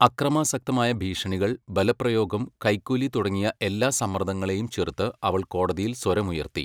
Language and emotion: Malayalam, neutral